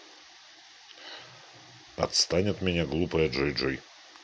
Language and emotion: Russian, neutral